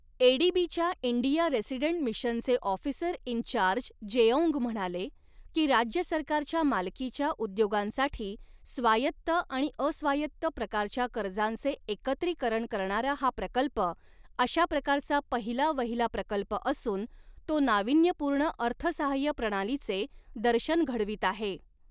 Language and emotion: Marathi, neutral